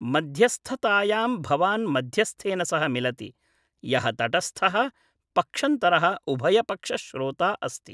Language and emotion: Sanskrit, neutral